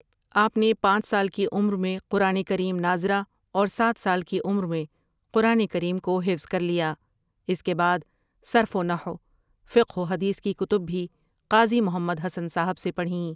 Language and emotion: Urdu, neutral